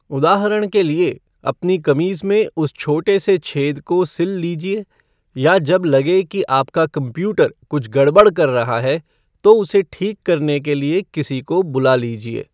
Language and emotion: Hindi, neutral